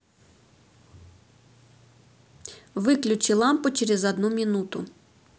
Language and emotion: Russian, neutral